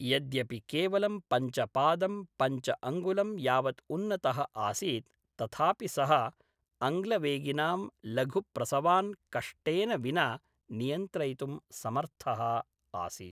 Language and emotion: Sanskrit, neutral